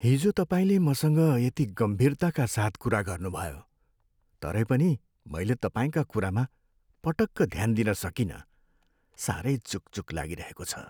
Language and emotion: Nepali, sad